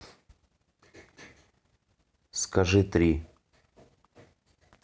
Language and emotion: Russian, neutral